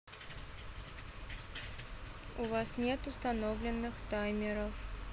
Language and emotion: Russian, neutral